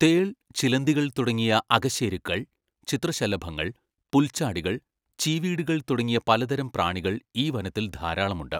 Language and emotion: Malayalam, neutral